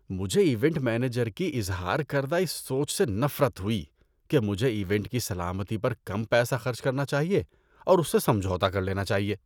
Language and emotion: Urdu, disgusted